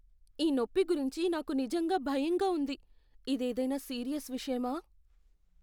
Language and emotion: Telugu, fearful